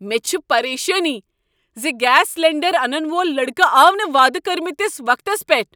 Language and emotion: Kashmiri, angry